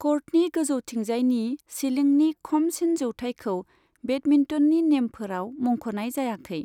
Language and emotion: Bodo, neutral